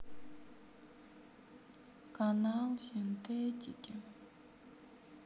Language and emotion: Russian, sad